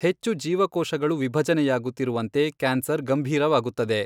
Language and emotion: Kannada, neutral